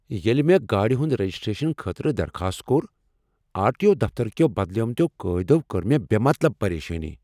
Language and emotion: Kashmiri, angry